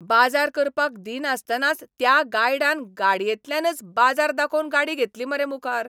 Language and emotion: Goan Konkani, angry